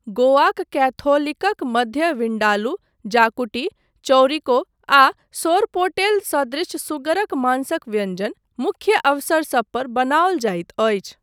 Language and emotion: Maithili, neutral